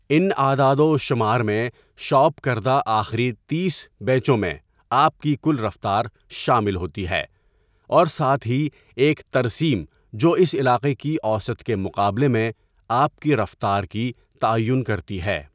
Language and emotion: Urdu, neutral